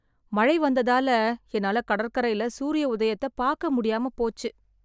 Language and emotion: Tamil, sad